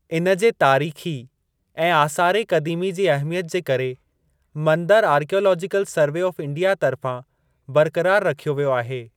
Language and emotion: Sindhi, neutral